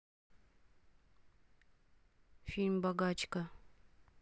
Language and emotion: Russian, neutral